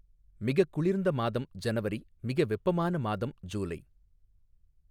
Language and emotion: Tamil, neutral